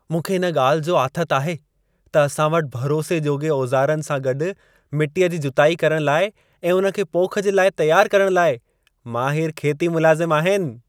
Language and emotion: Sindhi, happy